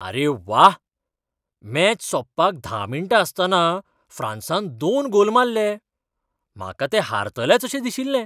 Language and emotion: Goan Konkani, surprised